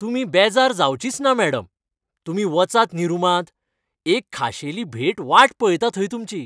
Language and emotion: Goan Konkani, happy